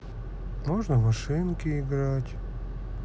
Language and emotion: Russian, sad